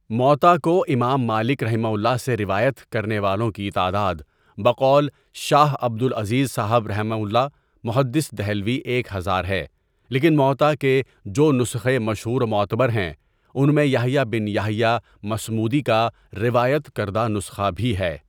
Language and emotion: Urdu, neutral